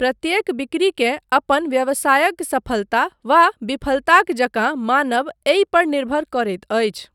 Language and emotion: Maithili, neutral